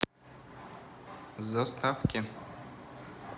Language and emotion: Russian, neutral